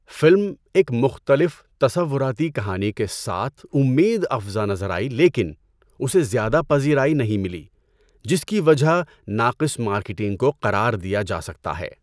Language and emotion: Urdu, neutral